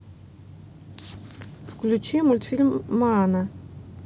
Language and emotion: Russian, neutral